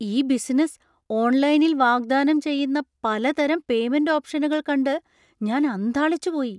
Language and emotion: Malayalam, surprised